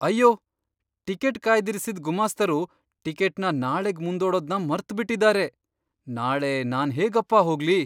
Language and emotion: Kannada, surprised